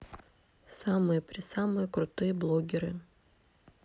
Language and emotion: Russian, neutral